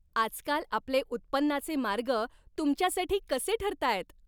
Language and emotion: Marathi, happy